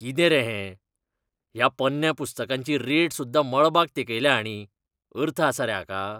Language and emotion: Goan Konkani, disgusted